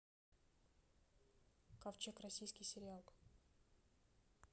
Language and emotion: Russian, neutral